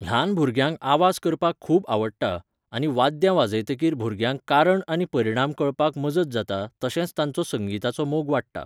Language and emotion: Goan Konkani, neutral